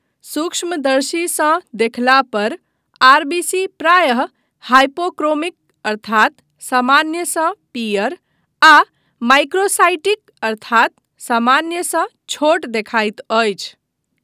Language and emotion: Maithili, neutral